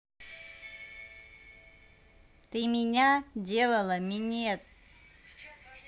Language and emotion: Russian, neutral